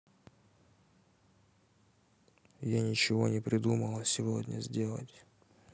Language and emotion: Russian, sad